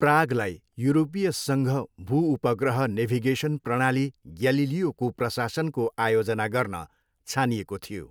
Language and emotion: Nepali, neutral